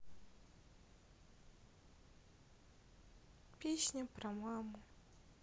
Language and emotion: Russian, sad